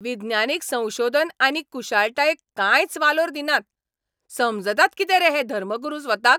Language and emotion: Goan Konkani, angry